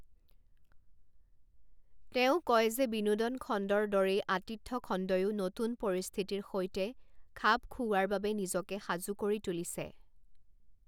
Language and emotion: Assamese, neutral